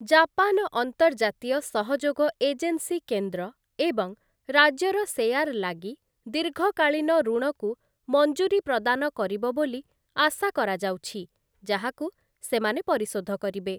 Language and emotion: Odia, neutral